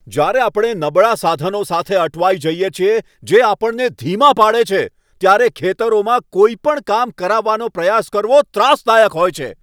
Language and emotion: Gujarati, angry